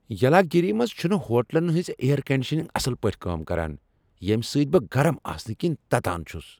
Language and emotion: Kashmiri, angry